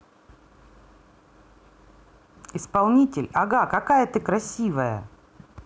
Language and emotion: Russian, positive